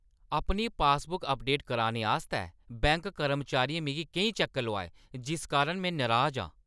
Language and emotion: Dogri, angry